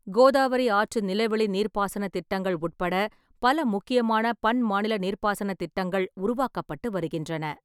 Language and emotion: Tamil, neutral